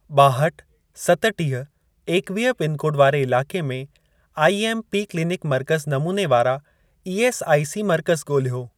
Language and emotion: Sindhi, neutral